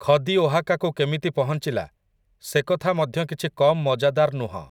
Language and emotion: Odia, neutral